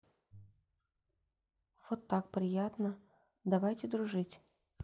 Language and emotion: Russian, neutral